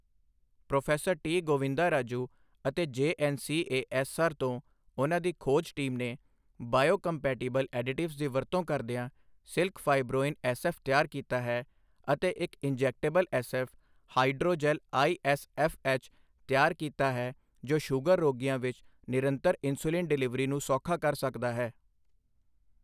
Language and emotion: Punjabi, neutral